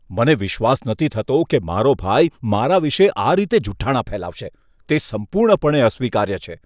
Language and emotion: Gujarati, disgusted